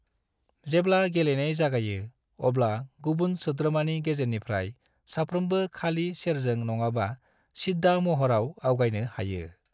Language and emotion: Bodo, neutral